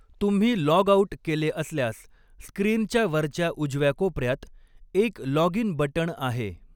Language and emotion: Marathi, neutral